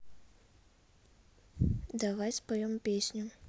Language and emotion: Russian, neutral